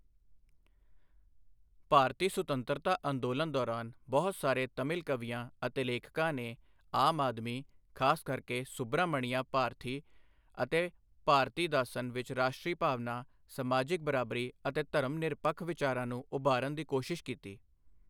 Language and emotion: Punjabi, neutral